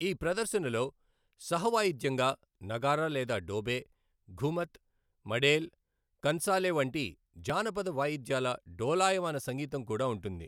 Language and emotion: Telugu, neutral